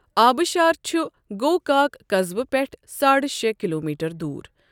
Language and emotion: Kashmiri, neutral